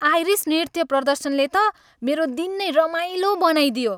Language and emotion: Nepali, happy